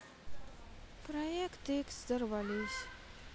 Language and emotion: Russian, sad